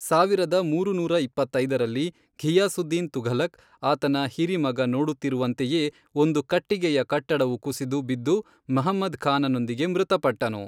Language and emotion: Kannada, neutral